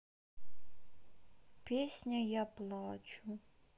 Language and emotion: Russian, sad